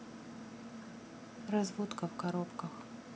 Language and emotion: Russian, neutral